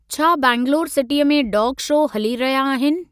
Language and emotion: Sindhi, neutral